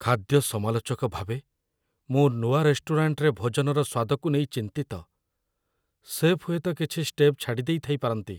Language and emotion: Odia, fearful